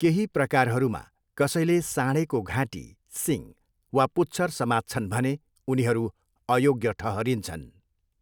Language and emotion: Nepali, neutral